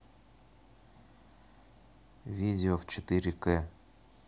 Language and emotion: Russian, neutral